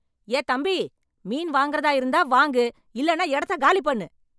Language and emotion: Tamil, angry